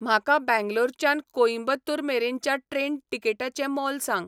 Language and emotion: Goan Konkani, neutral